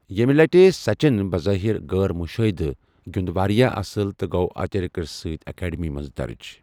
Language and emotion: Kashmiri, neutral